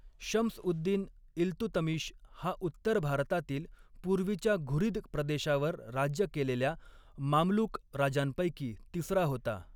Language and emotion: Marathi, neutral